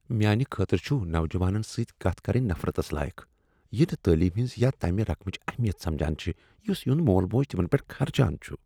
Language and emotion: Kashmiri, disgusted